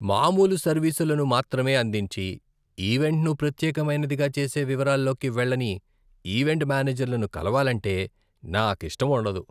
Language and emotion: Telugu, disgusted